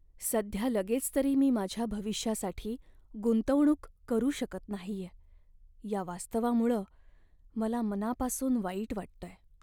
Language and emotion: Marathi, sad